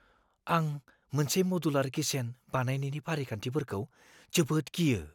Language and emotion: Bodo, fearful